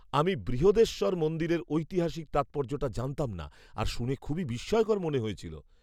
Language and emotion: Bengali, surprised